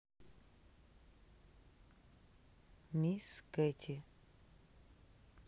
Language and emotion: Russian, neutral